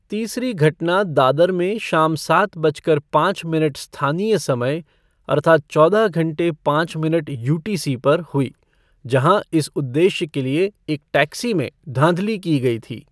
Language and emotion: Hindi, neutral